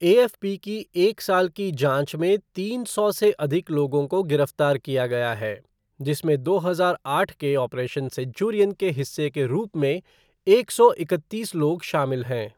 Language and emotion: Hindi, neutral